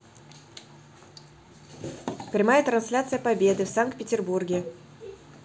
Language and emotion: Russian, neutral